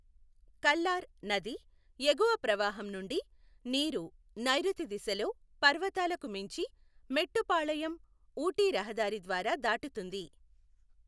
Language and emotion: Telugu, neutral